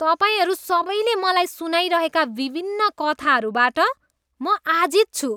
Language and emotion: Nepali, disgusted